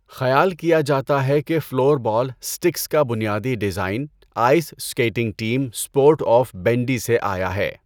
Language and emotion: Urdu, neutral